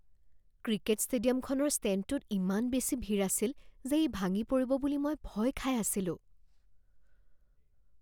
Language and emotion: Assamese, fearful